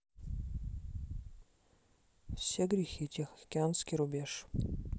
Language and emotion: Russian, neutral